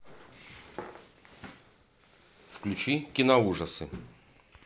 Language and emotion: Russian, neutral